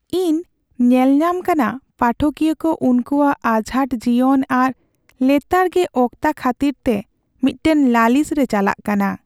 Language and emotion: Santali, sad